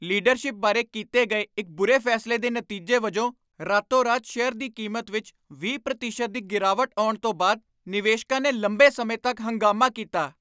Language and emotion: Punjabi, angry